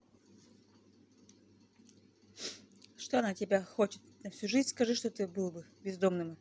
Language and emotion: Russian, angry